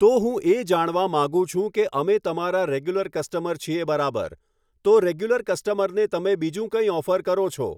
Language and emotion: Gujarati, neutral